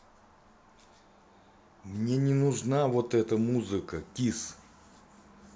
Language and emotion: Russian, angry